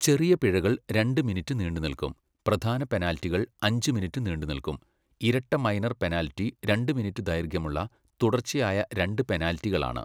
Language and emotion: Malayalam, neutral